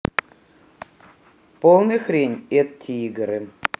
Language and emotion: Russian, neutral